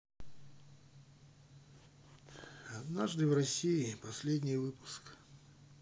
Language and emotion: Russian, sad